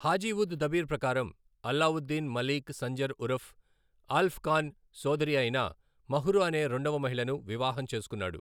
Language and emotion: Telugu, neutral